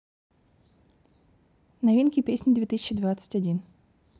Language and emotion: Russian, neutral